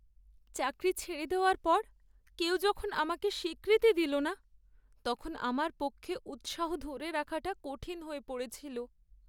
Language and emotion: Bengali, sad